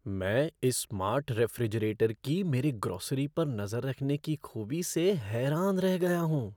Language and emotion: Hindi, surprised